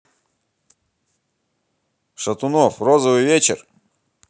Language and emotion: Russian, positive